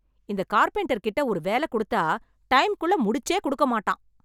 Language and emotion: Tamil, angry